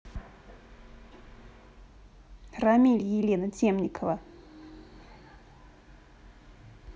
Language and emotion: Russian, neutral